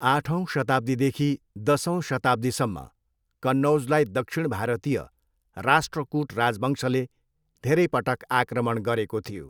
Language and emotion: Nepali, neutral